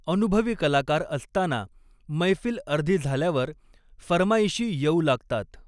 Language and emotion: Marathi, neutral